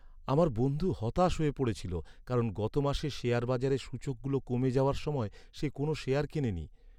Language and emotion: Bengali, sad